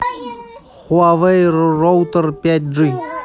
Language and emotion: Russian, neutral